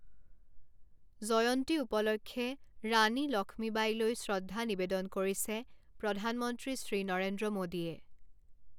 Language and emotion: Assamese, neutral